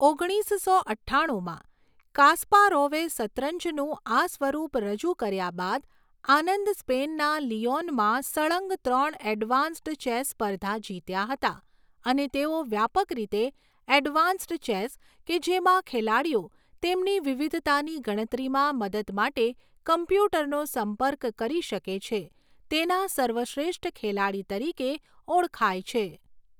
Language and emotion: Gujarati, neutral